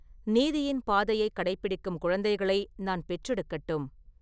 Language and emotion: Tamil, neutral